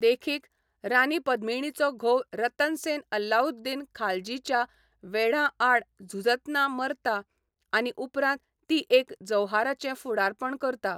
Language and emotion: Goan Konkani, neutral